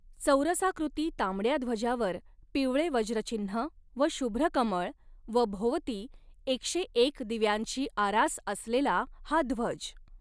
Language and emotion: Marathi, neutral